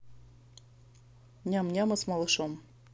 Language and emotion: Russian, neutral